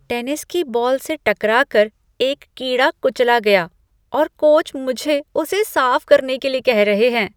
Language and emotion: Hindi, disgusted